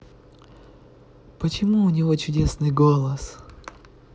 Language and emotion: Russian, positive